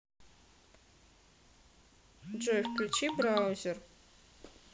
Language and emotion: Russian, neutral